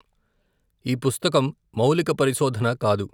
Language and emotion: Telugu, neutral